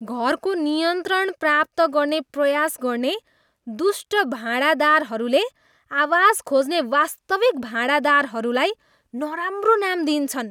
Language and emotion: Nepali, disgusted